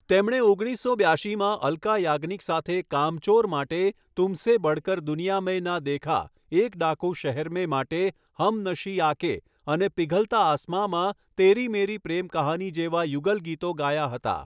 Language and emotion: Gujarati, neutral